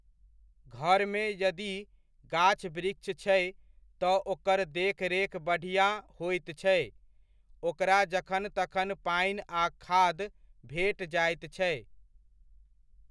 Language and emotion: Maithili, neutral